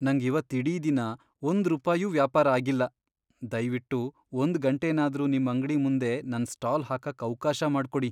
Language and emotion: Kannada, sad